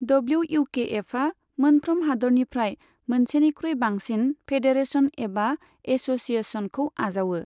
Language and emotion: Bodo, neutral